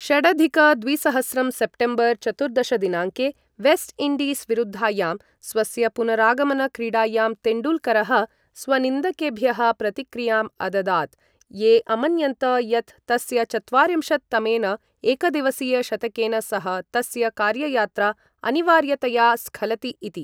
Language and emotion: Sanskrit, neutral